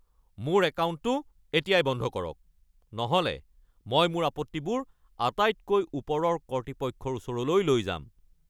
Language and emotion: Assamese, angry